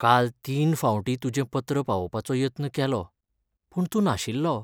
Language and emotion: Goan Konkani, sad